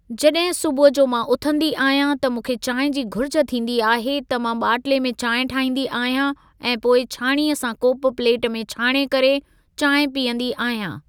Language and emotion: Sindhi, neutral